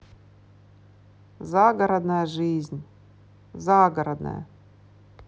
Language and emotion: Russian, neutral